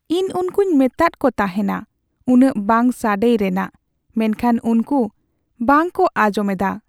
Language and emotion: Santali, sad